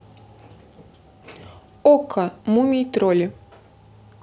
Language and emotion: Russian, neutral